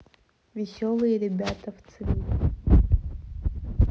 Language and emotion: Russian, neutral